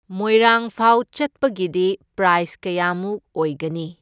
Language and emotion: Manipuri, neutral